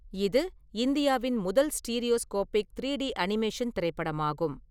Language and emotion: Tamil, neutral